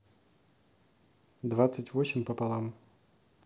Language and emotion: Russian, neutral